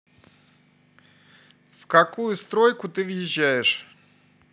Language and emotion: Russian, neutral